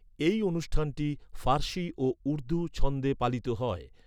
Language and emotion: Bengali, neutral